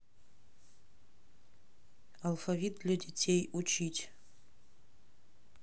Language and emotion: Russian, neutral